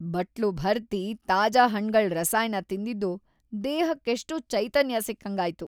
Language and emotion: Kannada, happy